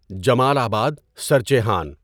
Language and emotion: Urdu, neutral